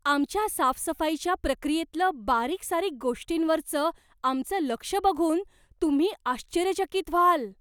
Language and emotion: Marathi, surprised